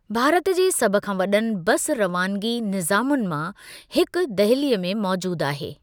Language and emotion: Sindhi, neutral